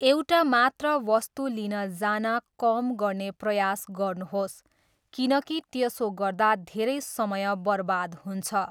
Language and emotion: Nepali, neutral